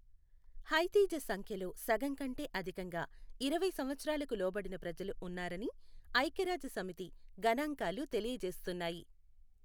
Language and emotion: Telugu, neutral